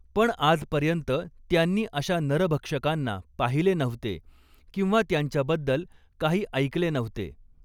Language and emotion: Marathi, neutral